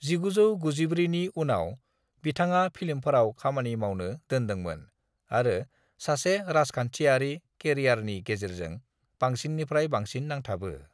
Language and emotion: Bodo, neutral